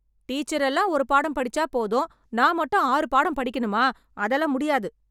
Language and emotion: Tamil, angry